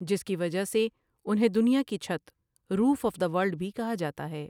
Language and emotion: Urdu, neutral